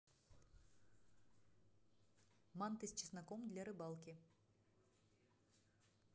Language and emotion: Russian, neutral